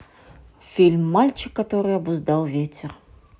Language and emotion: Russian, neutral